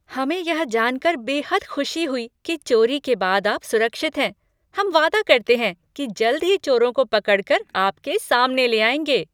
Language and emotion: Hindi, happy